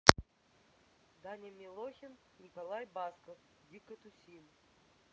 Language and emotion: Russian, neutral